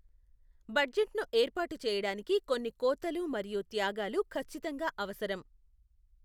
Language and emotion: Telugu, neutral